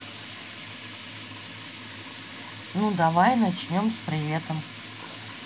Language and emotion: Russian, neutral